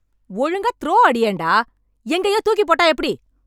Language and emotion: Tamil, angry